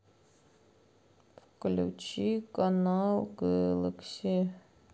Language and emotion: Russian, sad